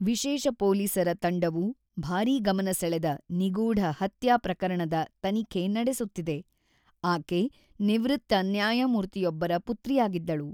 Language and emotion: Kannada, neutral